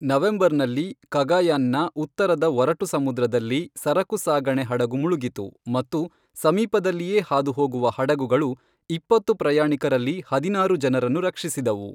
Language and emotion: Kannada, neutral